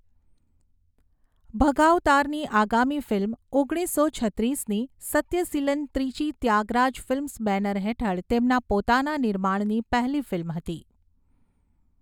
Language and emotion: Gujarati, neutral